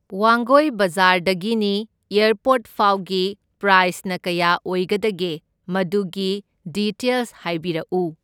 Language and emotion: Manipuri, neutral